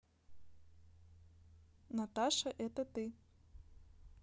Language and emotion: Russian, neutral